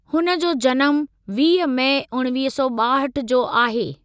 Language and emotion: Sindhi, neutral